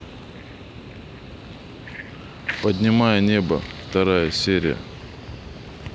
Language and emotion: Russian, neutral